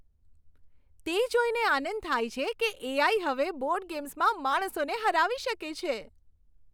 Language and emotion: Gujarati, happy